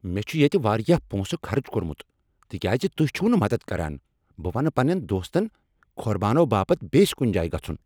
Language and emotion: Kashmiri, angry